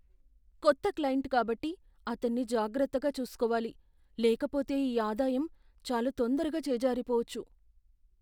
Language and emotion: Telugu, fearful